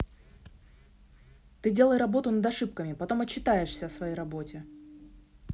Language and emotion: Russian, angry